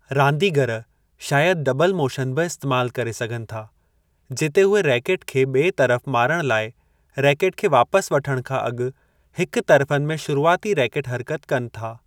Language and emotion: Sindhi, neutral